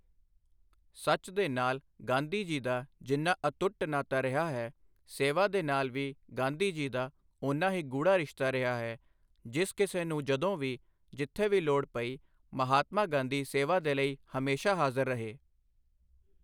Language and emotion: Punjabi, neutral